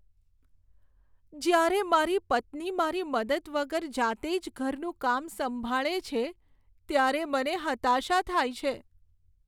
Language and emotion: Gujarati, sad